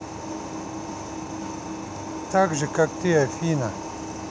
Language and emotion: Russian, neutral